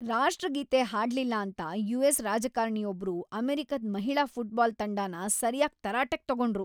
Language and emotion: Kannada, angry